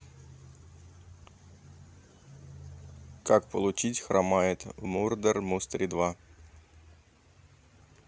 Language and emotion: Russian, neutral